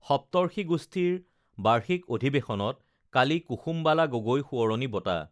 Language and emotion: Assamese, neutral